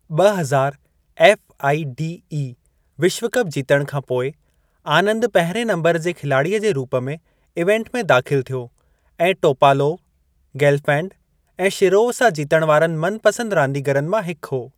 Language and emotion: Sindhi, neutral